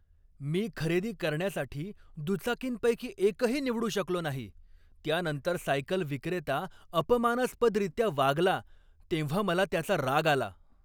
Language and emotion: Marathi, angry